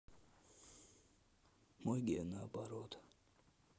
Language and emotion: Russian, sad